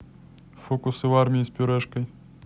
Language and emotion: Russian, neutral